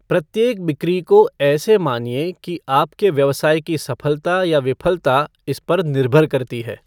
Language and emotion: Hindi, neutral